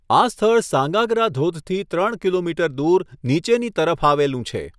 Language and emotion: Gujarati, neutral